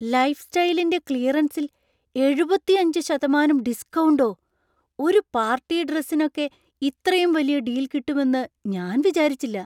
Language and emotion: Malayalam, surprised